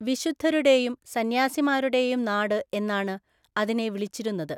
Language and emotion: Malayalam, neutral